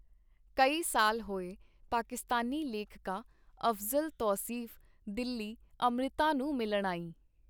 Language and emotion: Punjabi, neutral